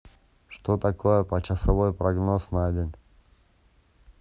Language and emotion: Russian, neutral